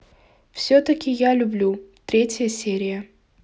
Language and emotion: Russian, neutral